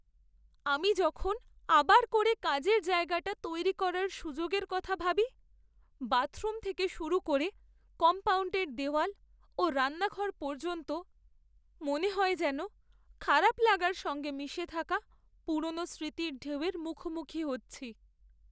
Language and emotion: Bengali, sad